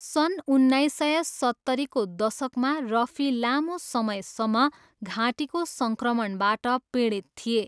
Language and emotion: Nepali, neutral